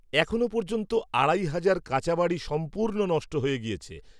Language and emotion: Bengali, neutral